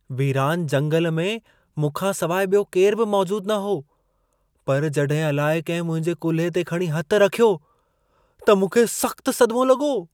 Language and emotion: Sindhi, surprised